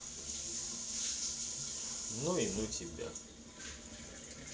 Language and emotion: Russian, neutral